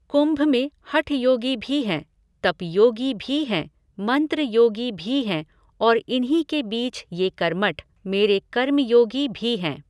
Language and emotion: Hindi, neutral